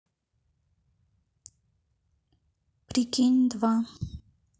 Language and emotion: Russian, neutral